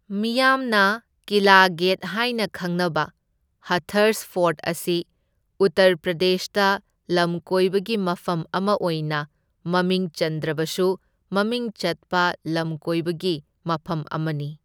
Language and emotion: Manipuri, neutral